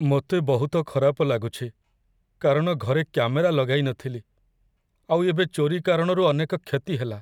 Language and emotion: Odia, sad